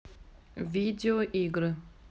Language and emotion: Russian, neutral